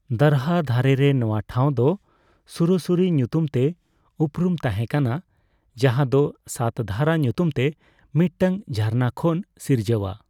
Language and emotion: Santali, neutral